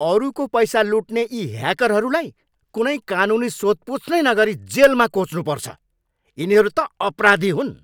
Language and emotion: Nepali, angry